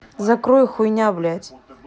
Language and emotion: Russian, angry